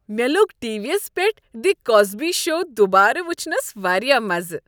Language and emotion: Kashmiri, happy